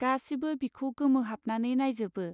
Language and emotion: Bodo, neutral